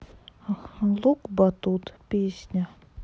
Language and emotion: Russian, sad